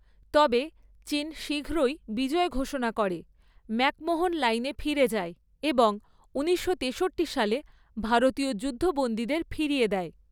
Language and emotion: Bengali, neutral